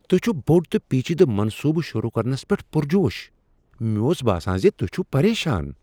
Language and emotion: Kashmiri, surprised